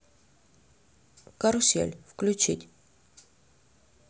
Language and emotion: Russian, neutral